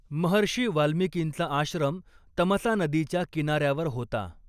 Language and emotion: Marathi, neutral